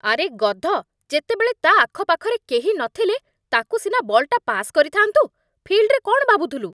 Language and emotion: Odia, angry